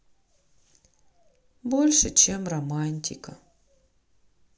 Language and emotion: Russian, sad